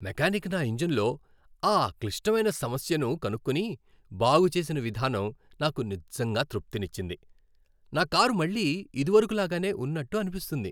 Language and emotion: Telugu, happy